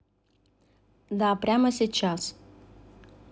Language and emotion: Russian, neutral